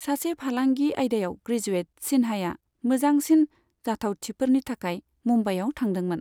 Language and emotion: Bodo, neutral